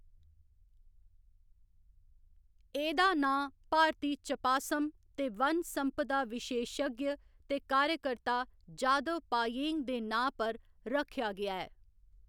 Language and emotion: Dogri, neutral